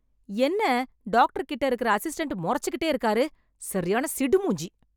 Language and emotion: Tamil, angry